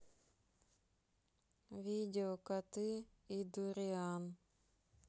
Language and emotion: Russian, sad